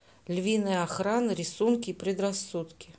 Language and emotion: Russian, neutral